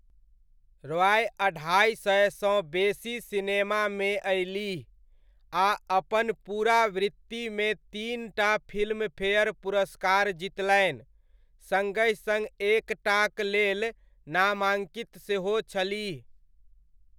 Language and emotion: Maithili, neutral